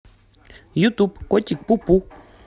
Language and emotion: Russian, positive